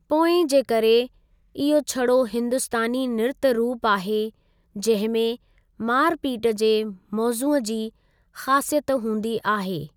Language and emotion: Sindhi, neutral